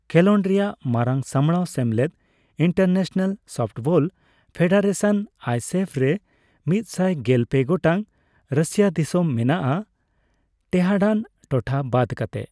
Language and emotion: Santali, neutral